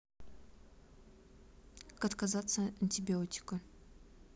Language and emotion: Russian, neutral